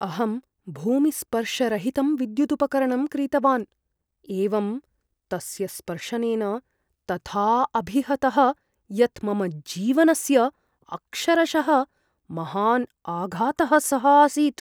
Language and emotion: Sanskrit, fearful